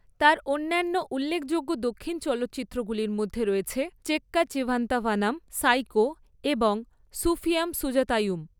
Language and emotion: Bengali, neutral